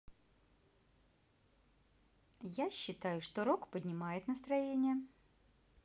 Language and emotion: Russian, positive